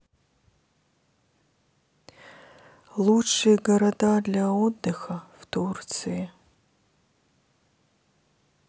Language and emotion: Russian, sad